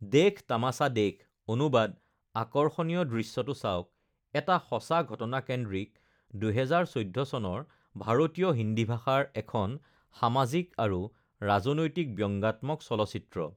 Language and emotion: Assamese, neutral